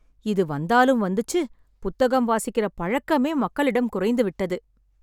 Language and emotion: Tamil, sad